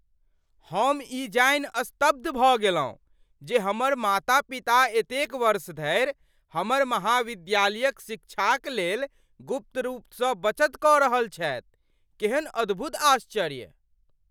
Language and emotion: Maithili, surprised